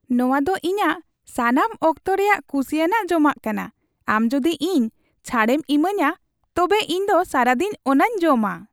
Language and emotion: Santali, happy